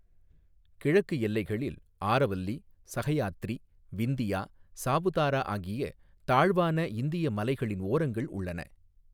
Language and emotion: Tamil, neutral